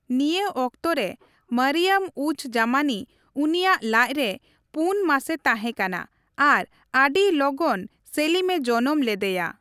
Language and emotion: Santali, neutral